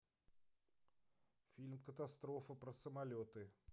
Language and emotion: Russian, neutral